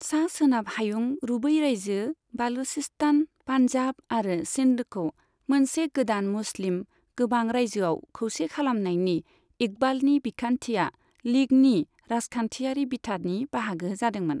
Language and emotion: Bodo, neutral